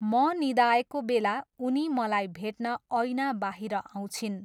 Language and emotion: Nepali, neutral